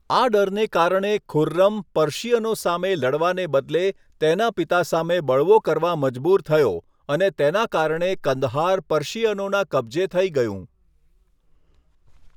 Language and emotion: Gujarati, neutral